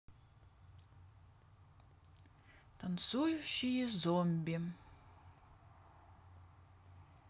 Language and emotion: Russian, neutral